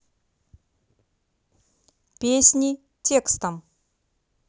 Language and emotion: Russian, neutral